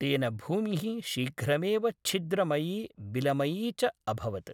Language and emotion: Sanskrit, neutral